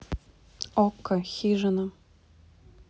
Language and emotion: Russian, neutral